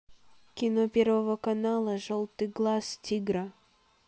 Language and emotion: Russian, neutral